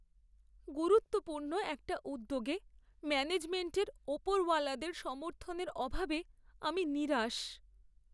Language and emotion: Bengali, sad